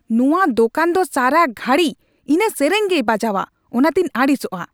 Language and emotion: Santali, angry